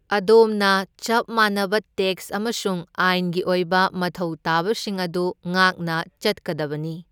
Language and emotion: Manipuri, neutral